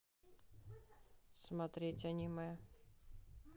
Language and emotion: Russian, neutral